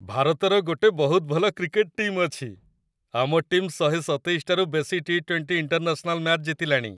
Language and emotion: Odia, happy